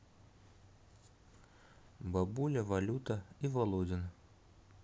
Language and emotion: Russian, neutral